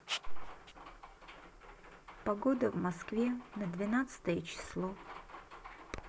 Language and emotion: Russian, sad